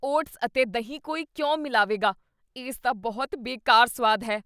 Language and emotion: Punjabi, disgusted